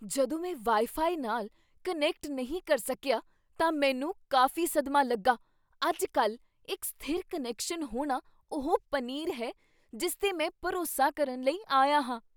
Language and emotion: Punjabi, surprised